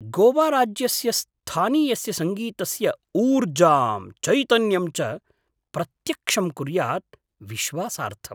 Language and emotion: Sanskrit, surprised